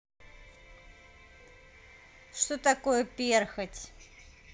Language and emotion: Russian, neutral